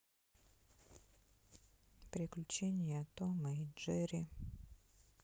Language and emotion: Russian, sad